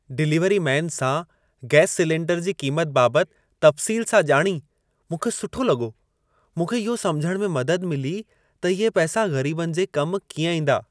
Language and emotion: Sindhi, happy